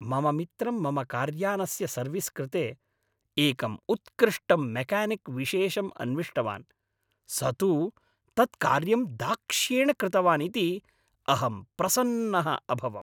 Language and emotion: Sanskrit, happy